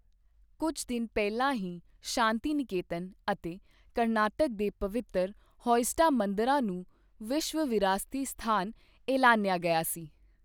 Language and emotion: Punjabi, neutral